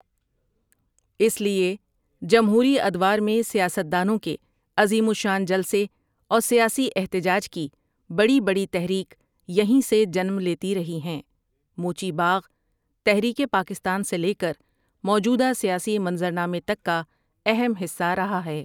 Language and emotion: Urdu, neutral